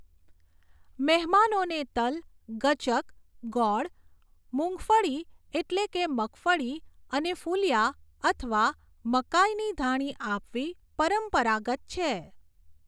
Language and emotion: Gujarati, neutral